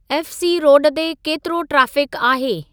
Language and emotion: Sindhi, neutral